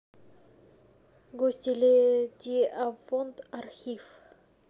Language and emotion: Russian, neutral